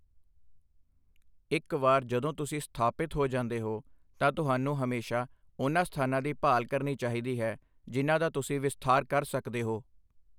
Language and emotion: Punjabi, neutral